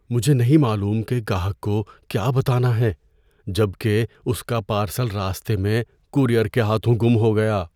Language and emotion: Urdu, fearful